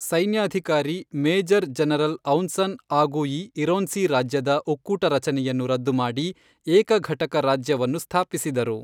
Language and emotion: Kannada, neutral